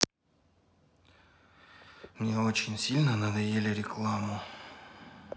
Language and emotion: Russian, sad